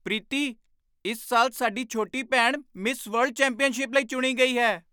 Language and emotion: Punjabi, surprised